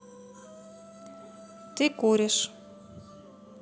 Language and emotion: Russian, neutral